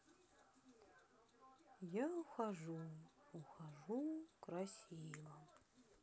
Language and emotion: Russian, sad